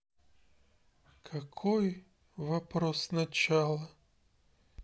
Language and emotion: Russian, sad